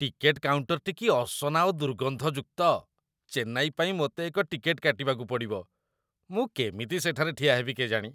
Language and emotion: Odia, disgusted